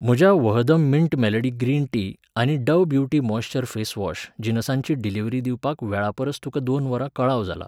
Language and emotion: Goan Konkani, neutral